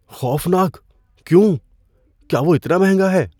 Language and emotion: Urdu, fearful